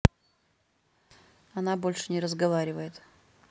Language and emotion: Russian, neutral